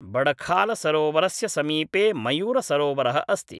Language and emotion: Sanskrit, neutral